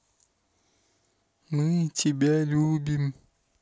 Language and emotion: Russian, neutral